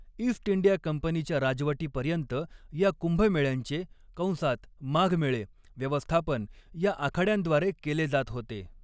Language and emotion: Marathi, neutral